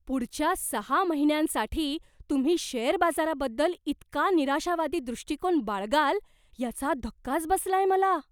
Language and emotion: Marathi, surprised